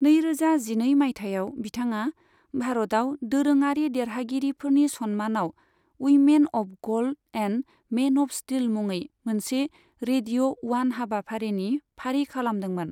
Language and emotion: Bodo, neutral